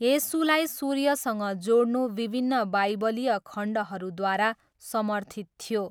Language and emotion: Nepali, neutral